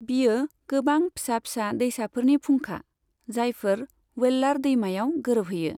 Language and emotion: Bodo, neutral